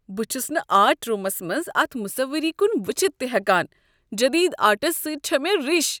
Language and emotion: Kashmiri, disgusted